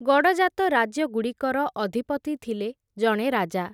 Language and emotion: Odia, neutral